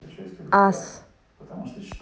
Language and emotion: Russian, neutral